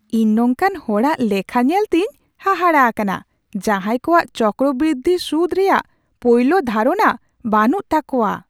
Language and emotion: Santali, surprised